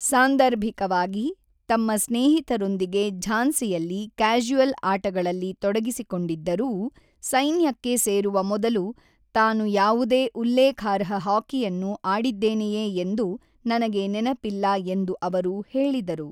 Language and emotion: Kannada, neutral